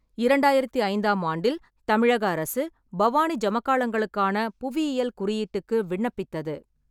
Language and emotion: Tamil, neutral